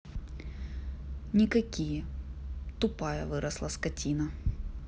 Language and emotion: Russian, angry